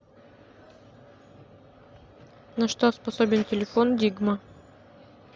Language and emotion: Russian, neutral